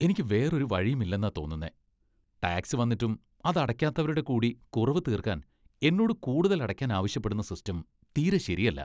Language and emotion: Malayalam, disgusted